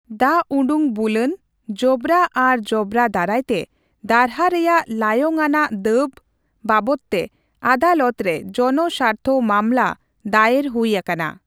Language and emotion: Santali, neutral